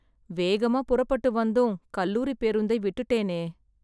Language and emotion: Tamil, sad